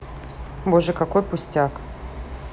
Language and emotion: Russian, neutral